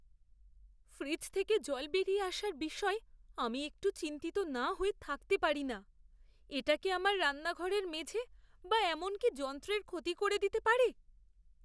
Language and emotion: Bengali, fearful